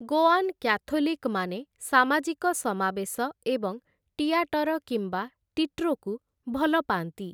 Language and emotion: Odia, neutral